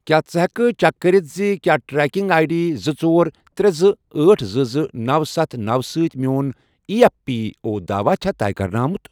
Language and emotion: Kashmiri, neutral